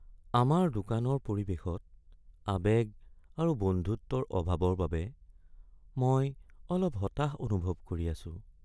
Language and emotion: Assamese, sad